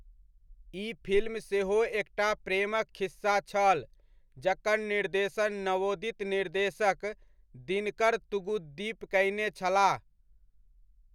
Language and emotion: Maithili, neutral